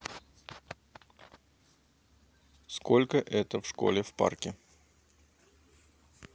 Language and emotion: Russian, neutral